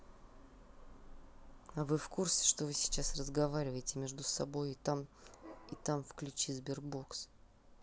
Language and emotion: Russian, neutral